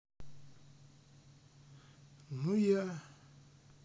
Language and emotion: Russian, sad